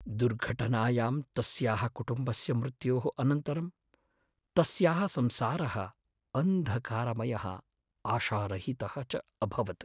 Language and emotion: Sanskrit, sad